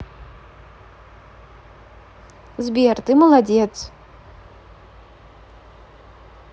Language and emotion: Russian, positive